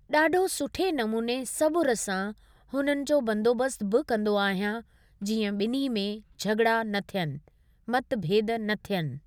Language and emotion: Sindhi, neutral